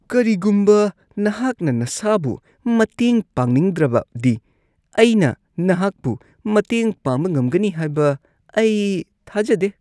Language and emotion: Manipuri, disgusted